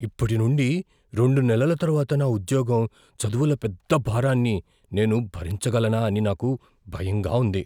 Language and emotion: Telugu, fearful